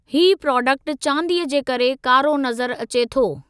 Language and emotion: Sindhi, neutral